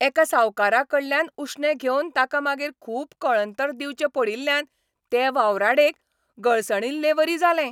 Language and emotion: Goan Konkani, angry